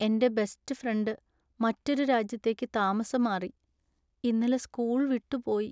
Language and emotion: Malayalam, sad